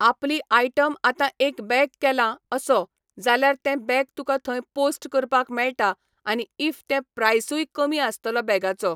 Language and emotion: Goan Konkani, neutral